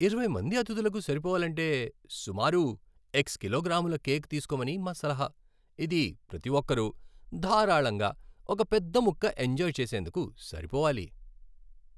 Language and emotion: Telugu, happy